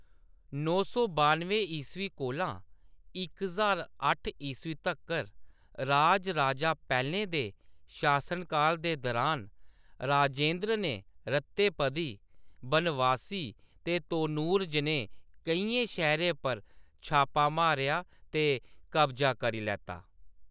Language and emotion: Dogri, neutral